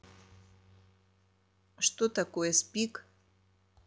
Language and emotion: Russian, neutral